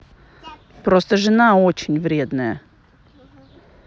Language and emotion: Russian, neutral